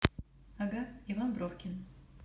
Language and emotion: Russian, neutral